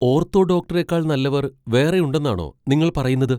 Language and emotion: Malayalam, surprised